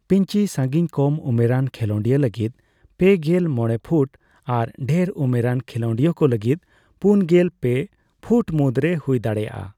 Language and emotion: Santali, neutral